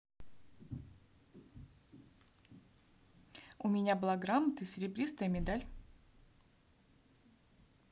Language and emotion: Russian, neutral